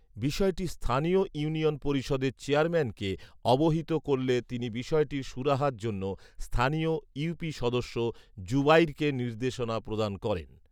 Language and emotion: Bengali, neutral